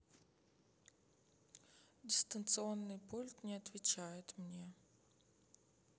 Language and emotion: Russian, sad